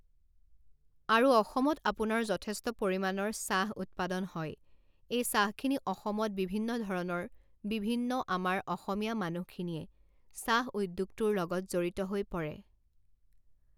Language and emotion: Assamese, neutral